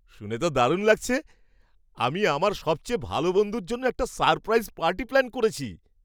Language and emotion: Bengali, surprised